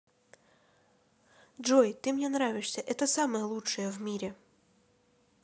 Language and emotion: Russian, positive